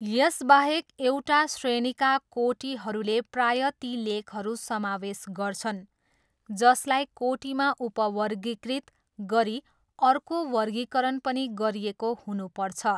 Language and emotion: Nepali, neutral